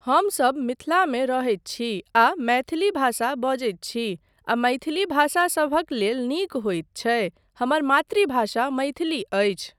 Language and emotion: Maithili, neutral